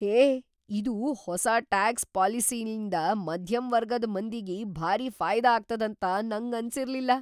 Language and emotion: Kannada, surprised